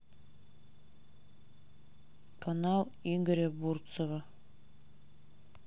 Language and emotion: Russian, neutral